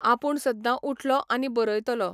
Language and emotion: Goan Konkani, neutral